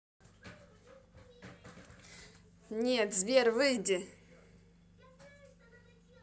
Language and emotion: Russian, angry